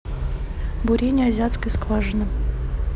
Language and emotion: Russian, neutral